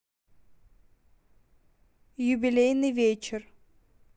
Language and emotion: Russian, neutral